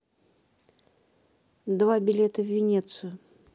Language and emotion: Russian, neutral